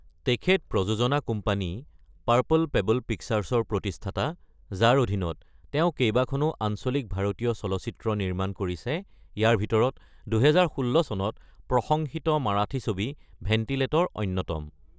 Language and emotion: Assamese, neutral